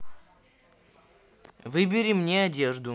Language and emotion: Russian, neutral